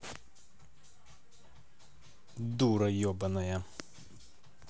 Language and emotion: Russian, angry